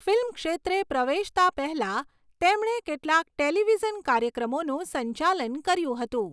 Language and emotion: Gujarati, neutral